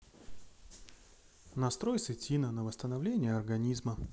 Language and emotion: Russian, neutral